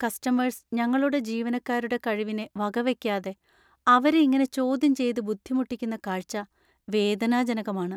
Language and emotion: Malayalam, sad